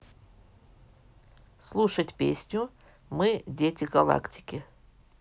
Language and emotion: Russian, neutral